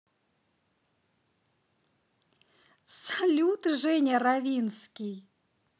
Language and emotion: Russian, positive